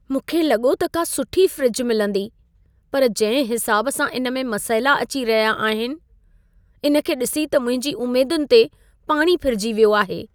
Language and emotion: Sindhi, sad